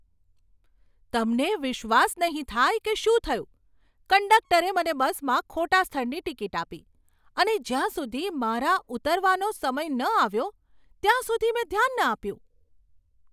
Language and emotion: Gujarati, surprised